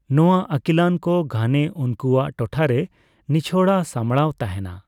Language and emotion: Santali, neutral